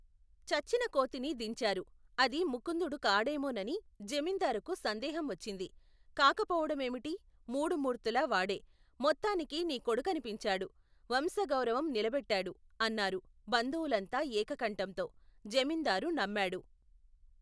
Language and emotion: Telugu, neutral